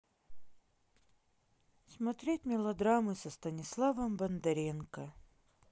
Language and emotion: Russian, sad